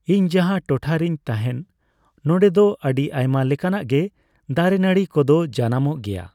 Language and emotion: Santali, neutral